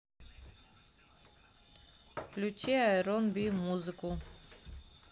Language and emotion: Russian, neutral